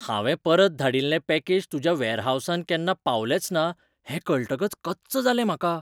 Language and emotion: Goan Konkani, surprised